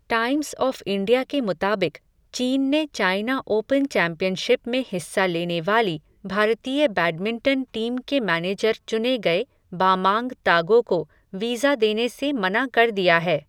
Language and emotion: Hindi, neutral